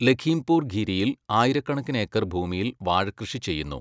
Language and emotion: Malayalam, neutral